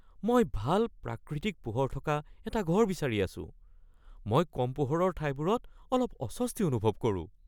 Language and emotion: Assamese, fearful